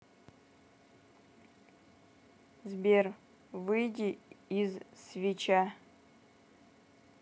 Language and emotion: Russian, neutral